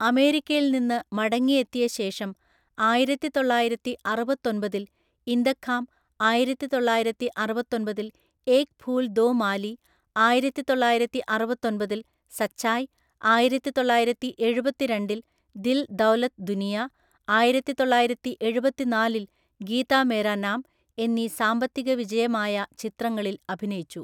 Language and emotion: Malayalam, neutral